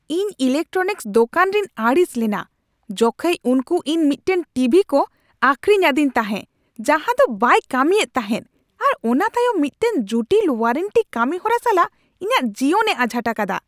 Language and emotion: Santali, angry